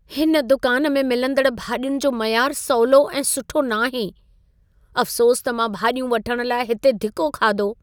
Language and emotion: Sindhi, sad